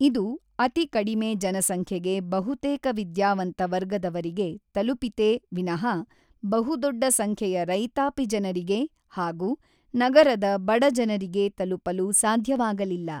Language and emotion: Kannada, neutral